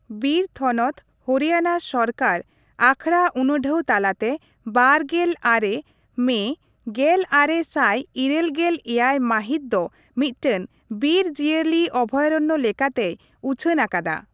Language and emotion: Santali, neutral